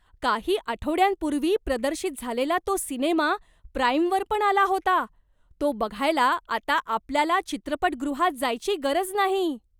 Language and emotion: Marathi, surprised